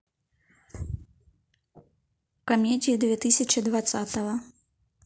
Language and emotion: Russian, neutral